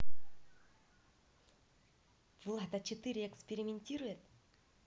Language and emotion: Russian, positive